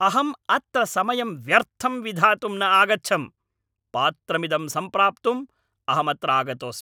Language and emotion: Sanskrit, angry